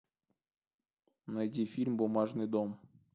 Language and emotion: Russian, neutral